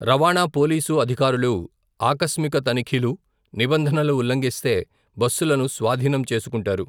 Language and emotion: Telugu, neutral